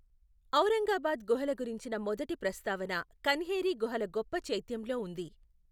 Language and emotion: Telugu, neutral